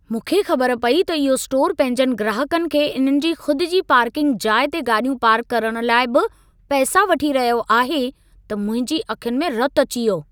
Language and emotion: Sindhi, angry